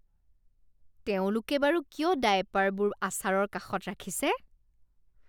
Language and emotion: Assamese, disgusted